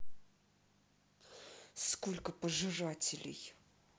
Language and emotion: Russian, angry